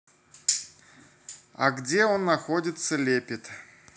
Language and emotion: Russian, neutral